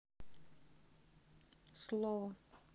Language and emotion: Russian, neutral